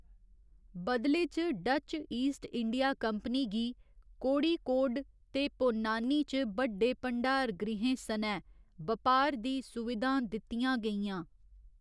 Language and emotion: Dogri, neutral